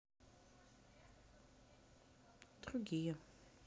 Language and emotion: Russian, neutral